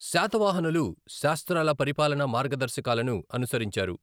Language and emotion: Telugu, neutral